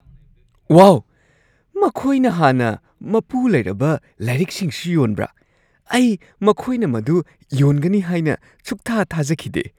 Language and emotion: Manipuri, surprised